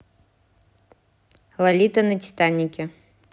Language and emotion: Russian, neutral